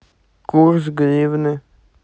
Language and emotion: Russian, neutral